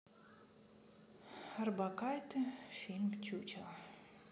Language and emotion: Russian, sad